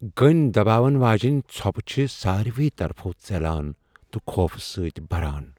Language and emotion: Kashmiri, fearful